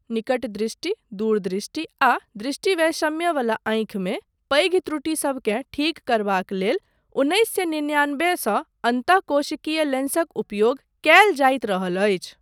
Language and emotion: Maithili, neutral